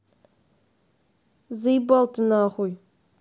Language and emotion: Russian, angry